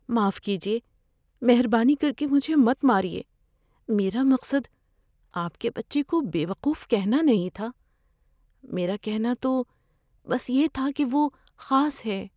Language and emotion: Urdu, fearful